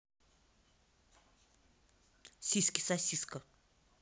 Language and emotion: Russian, angry